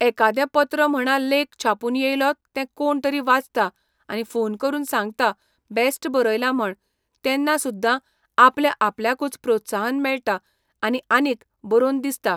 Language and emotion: Goan Konkani, neutral